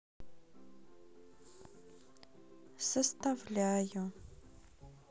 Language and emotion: Russian, sad